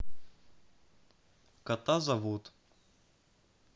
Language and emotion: Russian, neutral